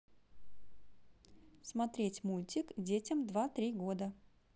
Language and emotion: Russian, neutral